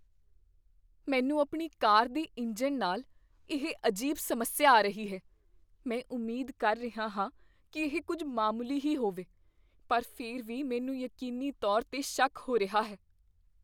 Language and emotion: Punjabi, fearful